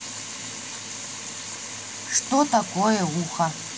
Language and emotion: Russian, neutral